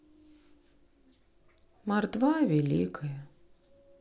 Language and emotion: Russian, sad